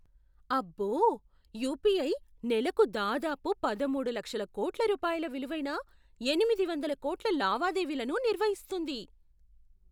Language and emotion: Telugu, surprised